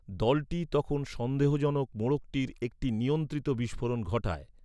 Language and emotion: Bengali, neutral